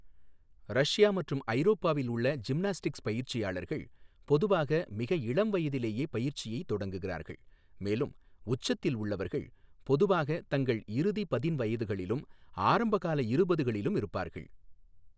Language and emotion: Tamil, neutral